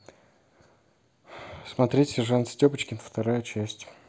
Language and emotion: Russian, neutral